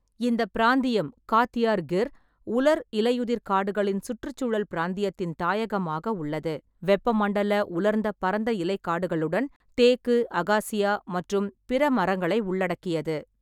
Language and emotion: Tamil, neutral